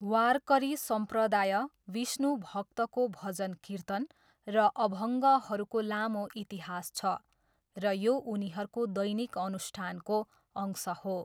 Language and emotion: Nepali, neutral